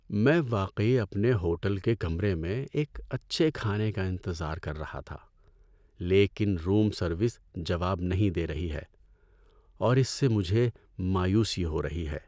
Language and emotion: Urdu, sad